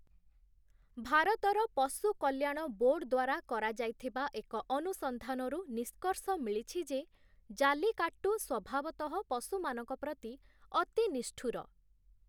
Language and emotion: Odia, neutral